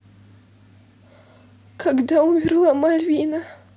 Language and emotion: Russian, sad